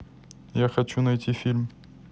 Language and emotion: Russian, neutral